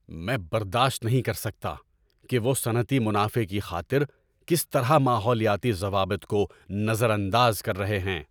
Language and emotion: Urdu, angry